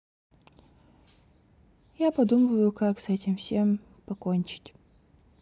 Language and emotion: Russian, sad